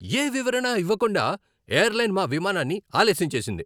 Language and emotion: Telugu, angry